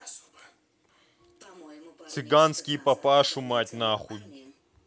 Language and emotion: Russian, angry